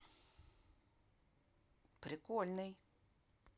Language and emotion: Russian, positive